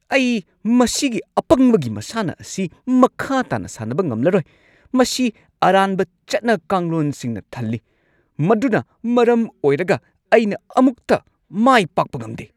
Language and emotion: Manipuri, angry